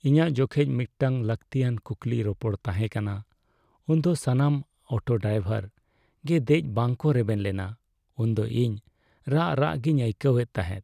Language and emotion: Santali, sad